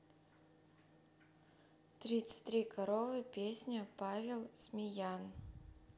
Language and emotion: Russian, neutral